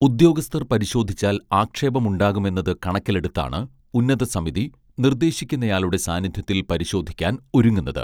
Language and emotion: Malayalam, neutral